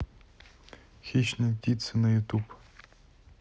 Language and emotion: Russian, neutral